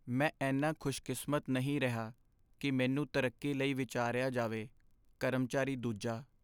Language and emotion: Punjabi, sad